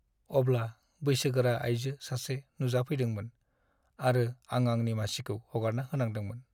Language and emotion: Bodo, sad